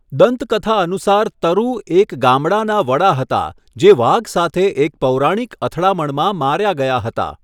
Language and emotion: Gujarati, neutral